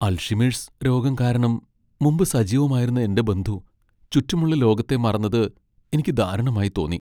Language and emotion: Malayalam, sad